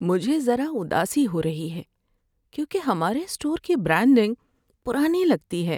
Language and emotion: Urdu, sad